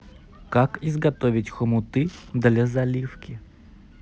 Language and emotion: Russian, neutral